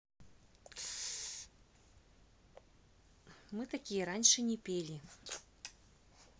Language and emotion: Russian, neutral